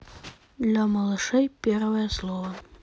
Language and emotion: Russian, neutral